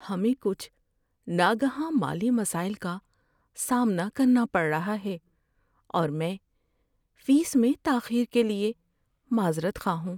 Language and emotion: Urdu, sad